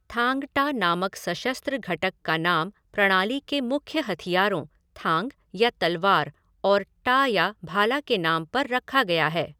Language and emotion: Hindi, neutral